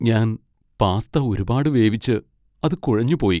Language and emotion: Malayalam, sad